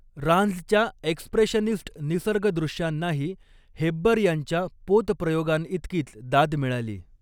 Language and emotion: Marathi, neutral